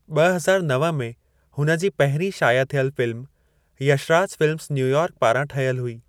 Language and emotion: Sindhi, neutral